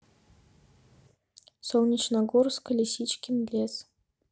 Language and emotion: Russian, neutral